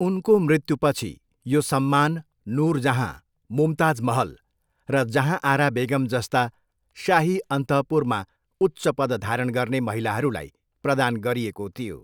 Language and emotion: Nepali, neutral